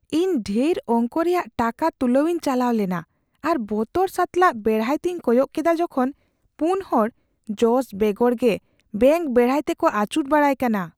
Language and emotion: Santali, fearful